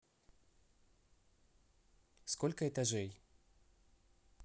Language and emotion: Russian, neutral